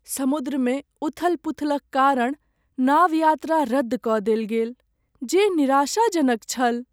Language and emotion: Maithili, sad